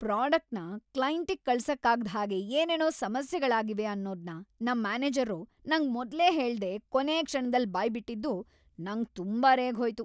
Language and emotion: Kannada, angry